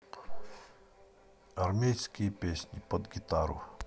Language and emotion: Russian, neutral